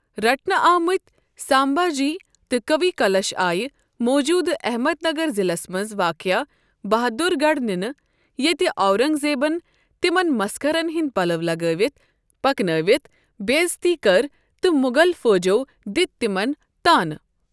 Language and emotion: Kashmiri, neutral